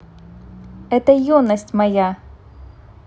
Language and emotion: Russian, neutral